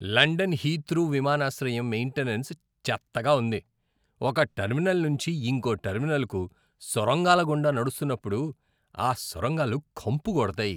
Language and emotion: Telugu, disgusted